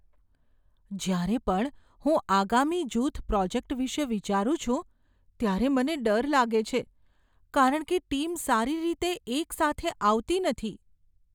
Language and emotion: Gujarati, fearful